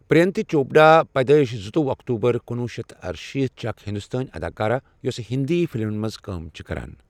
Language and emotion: Kashmiri, neutral